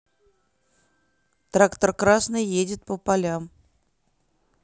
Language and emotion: Russian, neutral